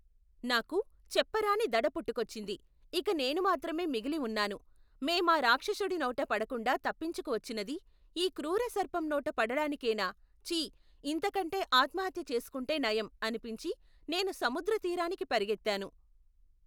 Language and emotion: Telugu, neutral